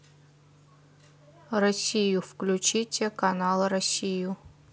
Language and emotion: Russian, neutral